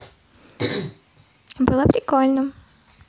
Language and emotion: Russian, positive